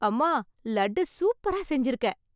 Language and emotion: Tamil, happy